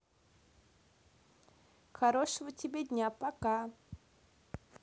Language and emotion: Russian, positive